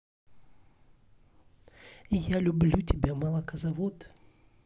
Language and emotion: Russian, positive